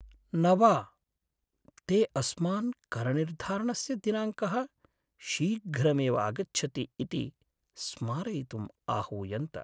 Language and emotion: Sanskrit, sad